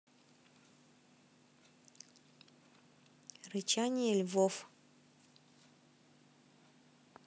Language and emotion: Russian, neutral